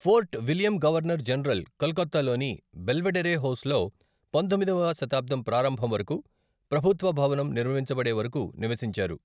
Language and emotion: Telugu, neutral